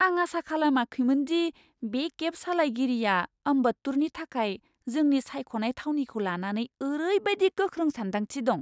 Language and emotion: Bodo, surprised